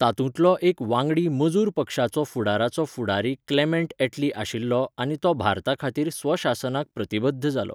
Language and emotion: Goan Konkani, neutral